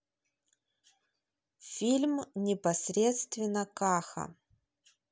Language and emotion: Russian, neutral